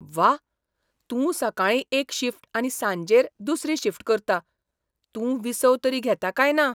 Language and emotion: Goan Konkani, surprised